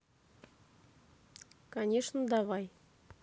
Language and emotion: Russian, neutral